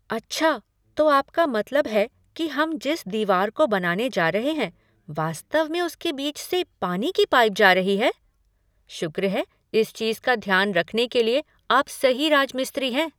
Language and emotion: Hindi, surprised